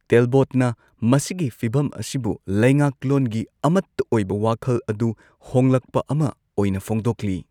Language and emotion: Manipuri, neutral